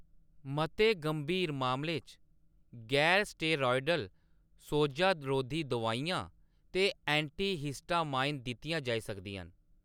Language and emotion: Dogri, neutral